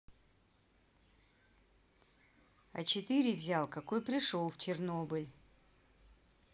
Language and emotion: Russian, neutral